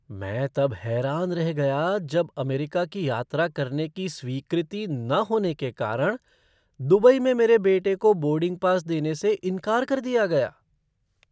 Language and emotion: Hindi, surprised